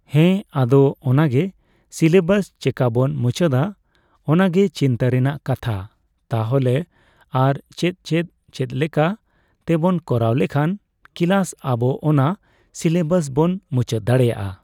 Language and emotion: Santali, neutral